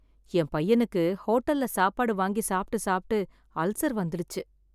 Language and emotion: Tamil, sad